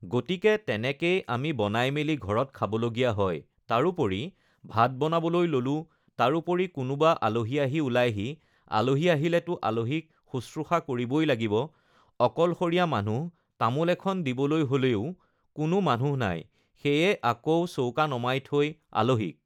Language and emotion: Assamese, neutral